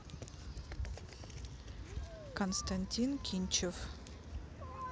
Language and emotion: Russian, neutral